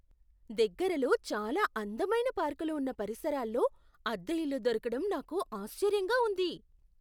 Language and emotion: Telugu, surprised